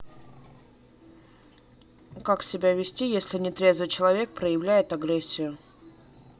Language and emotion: Russian, neutral